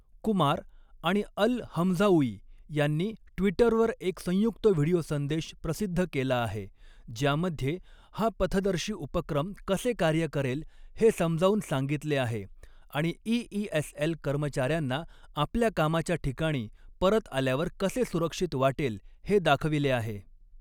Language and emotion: Marathi, neutral